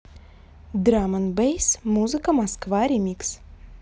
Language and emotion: Russian, neutral